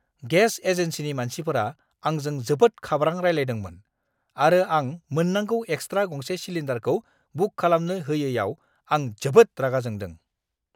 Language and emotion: Bodo, angry